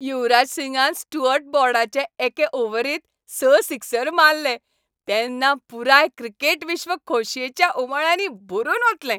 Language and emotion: Goan Konkani, happy